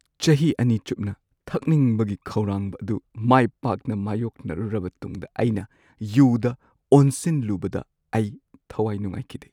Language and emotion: Manipuri, sad